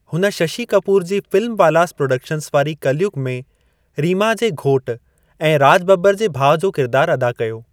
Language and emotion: Sindhi, neutral